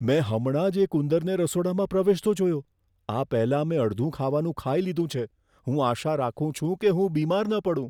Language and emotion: Gujarati, fearful